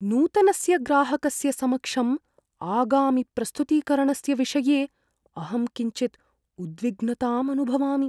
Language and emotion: Sanskrit, fearful